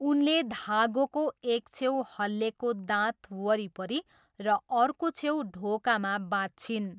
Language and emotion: Nepali, neutral